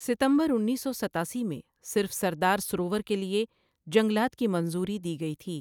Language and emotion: Urdu, neutral